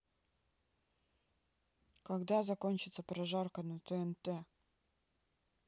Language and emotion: Russian, neutral